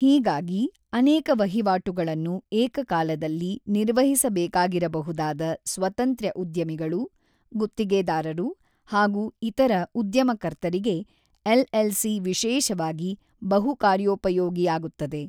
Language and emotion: Kannada, neutral